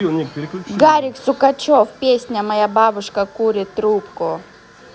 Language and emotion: Russian, neutral